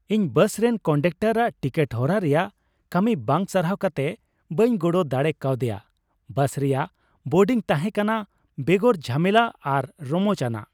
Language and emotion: Santali, happy